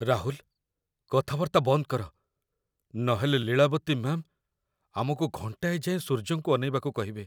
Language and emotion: Odia, fearful